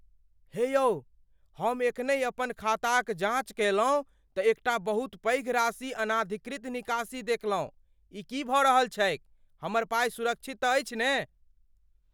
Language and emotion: Maithili, fearful